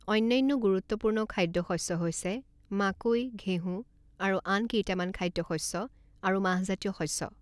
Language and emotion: Assamese, neutral